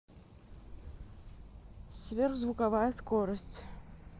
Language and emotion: Russian, neutral